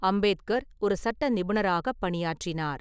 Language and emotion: Tamil, neutral